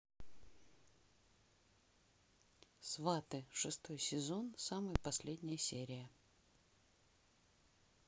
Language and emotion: Russian, neutral